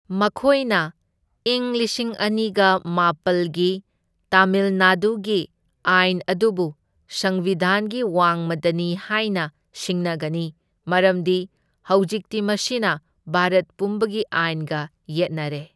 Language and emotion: Manipuri, neutral